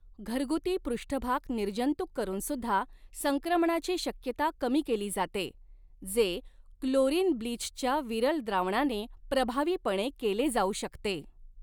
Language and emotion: Marathi, neutral